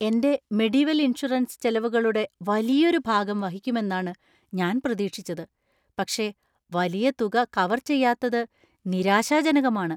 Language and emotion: Malayalam, surprised